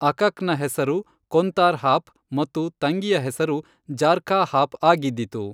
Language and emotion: Kannada, neutral